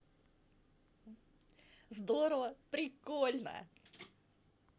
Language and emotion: Russian, positive